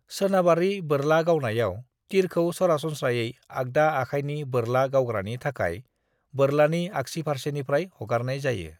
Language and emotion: Bodo, neutral